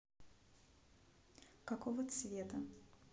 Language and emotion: Russian, neutral